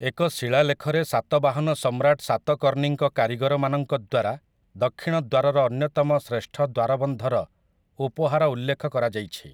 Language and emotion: Odia, neutral